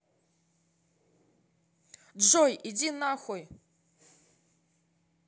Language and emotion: Russian, angry